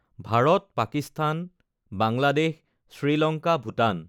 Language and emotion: Assamese, neutral